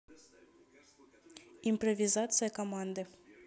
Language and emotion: Russian, neutral